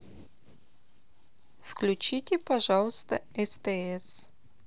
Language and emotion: Russian, neutral